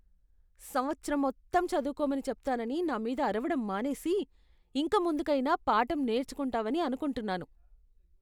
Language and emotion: Telugu, disgusted